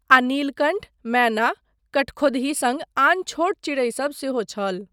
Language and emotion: Maithili, neutral